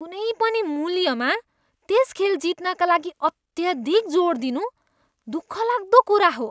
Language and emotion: Nepali, disgusted